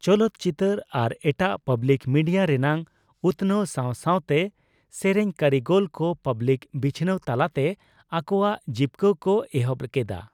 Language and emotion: Santali, neutral